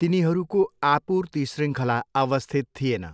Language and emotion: Nepali, neutral